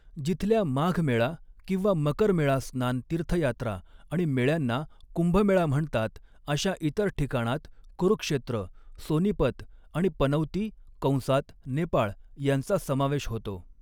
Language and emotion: Marathi, neutral